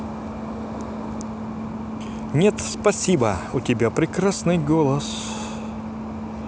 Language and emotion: Russian, positive